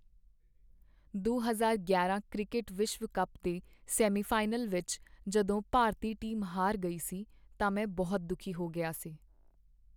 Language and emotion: Punjabi, sad